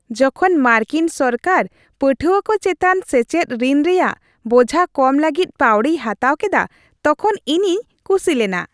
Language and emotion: Santali, happy